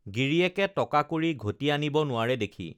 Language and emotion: Assamese, neutral